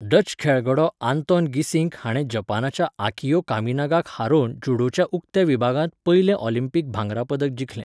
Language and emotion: Goan Konkani, neutral